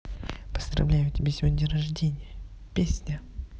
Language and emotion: Russian, neutral